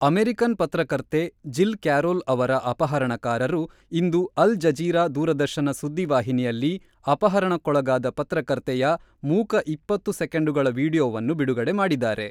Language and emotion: Kannada, neutral